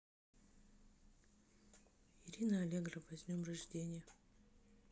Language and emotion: Russian, neutral